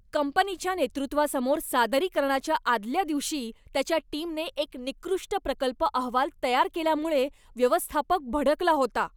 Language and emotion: Marathi, angry